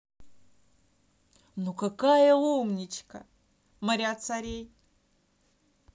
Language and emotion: Russian, positive